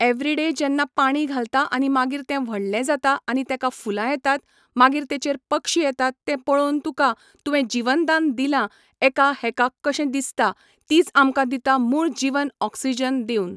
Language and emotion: Goan Konkani, neutral